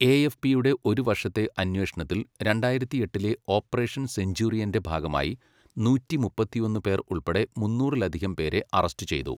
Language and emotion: Malayalam, neutral